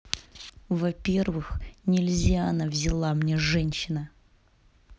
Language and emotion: Russian, angry